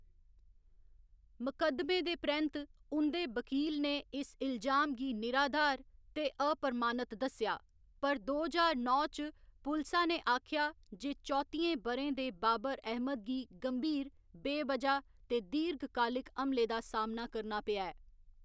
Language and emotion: Dogri, neutral